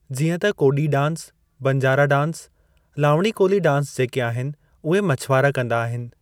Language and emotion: Sindhi, neutral